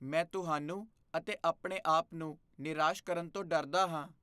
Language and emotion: Punjabi, fearful